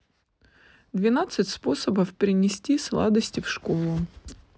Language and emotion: Russian, neutral